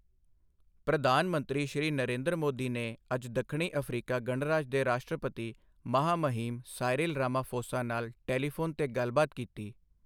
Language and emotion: Punjabi, neutral